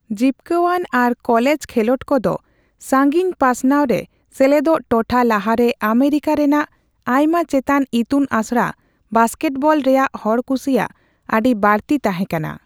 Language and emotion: Santali, neutral